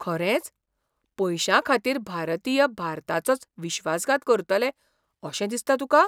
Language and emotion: Goan Konkani, surprised